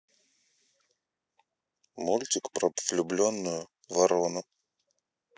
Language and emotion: Russian, neutral